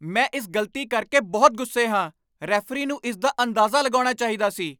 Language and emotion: Punjabi, angry